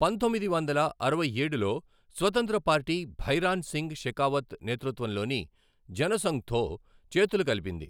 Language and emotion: Telugu, neutral